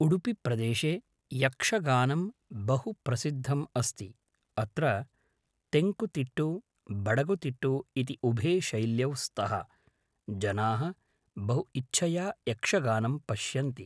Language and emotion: Sanskrit, neutral